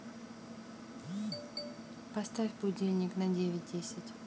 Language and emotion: Russian, neutral